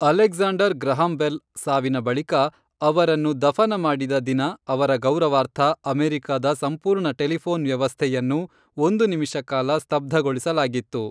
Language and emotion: Kannada, neutral